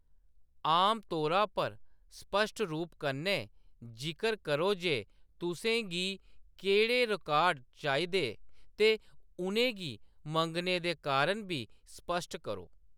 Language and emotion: Dogri, neutral